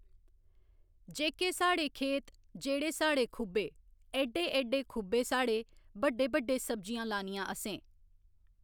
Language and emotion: Dogri, neutral